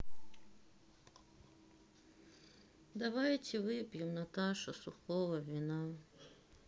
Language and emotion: Russian, sad